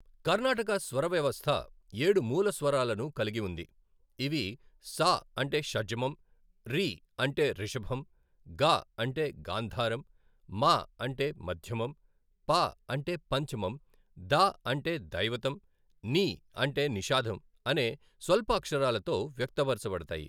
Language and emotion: Telugu, neutral